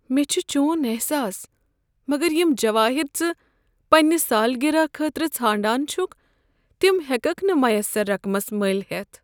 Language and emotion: Kashmiri, sad